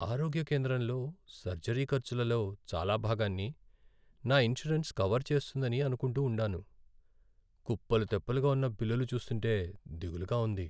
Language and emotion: Telugu, sad